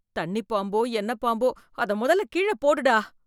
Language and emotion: Tamil, fearful